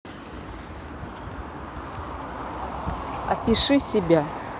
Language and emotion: Russian, neutral